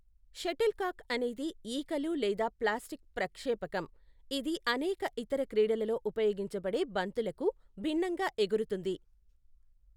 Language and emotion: Telugu, neutral